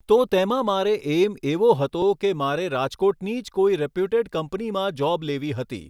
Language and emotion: Gujarati, neutral